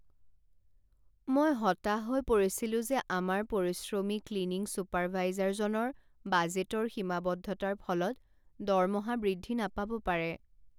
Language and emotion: Assamese, sad